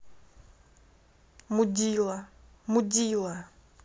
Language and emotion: Russian, angry